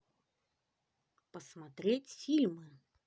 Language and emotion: Russian, positive